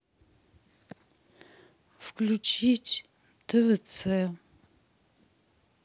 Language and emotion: Russian, sad